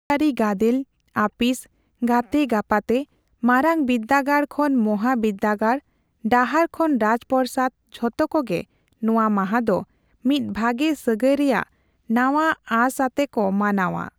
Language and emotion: Santali, neutral